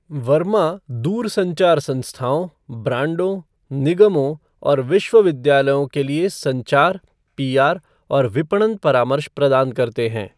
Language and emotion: Hindi, neutral